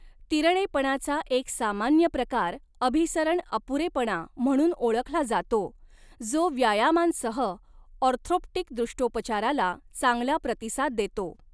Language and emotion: Marathi, neutral